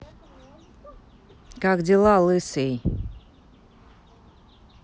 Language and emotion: Russian, neutral